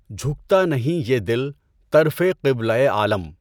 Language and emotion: Urdu, neutral